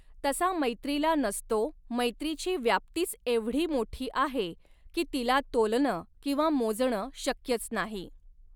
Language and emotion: Marathi, neutral